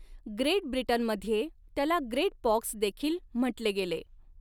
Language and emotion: Marathi, neutral